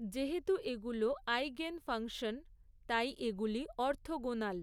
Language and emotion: Bengali, neutral